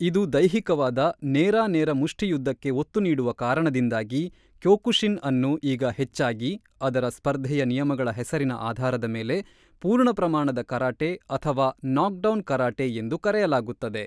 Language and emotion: Kannada, neutral